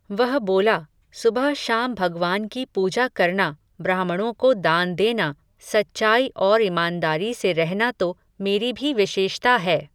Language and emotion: Hindi, neutral